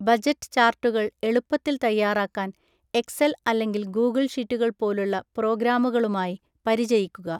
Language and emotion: Malayalam, neutral